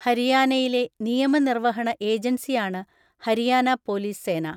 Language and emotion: Malayalam, neutral